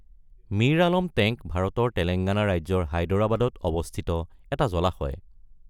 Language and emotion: Assamese, neutral